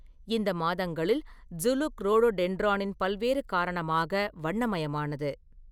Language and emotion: Tamil, neutral